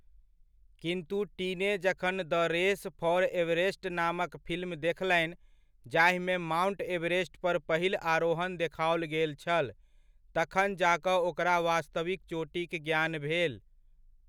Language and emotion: Maithili, neutral